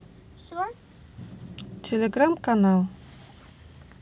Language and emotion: Russian, neutral